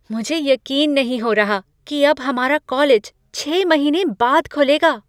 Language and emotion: Hindi, surprised